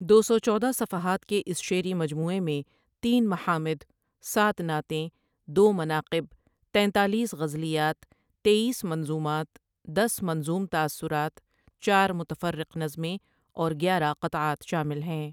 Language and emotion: Urdu, neutral